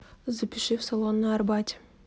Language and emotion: Russian, neutral